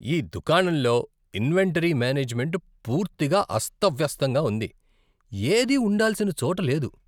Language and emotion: Telugu, disgusted